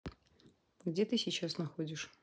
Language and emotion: Russian, neutral